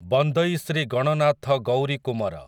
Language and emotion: Odia, neutral